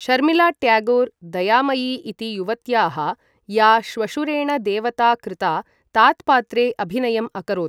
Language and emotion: Sanskrit, neutral